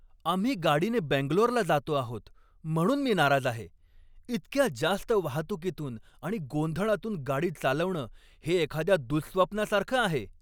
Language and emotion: Marathi, angry